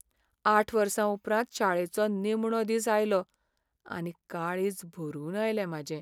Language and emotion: Goan Konkani, sad